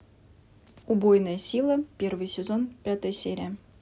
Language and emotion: Russian, neutral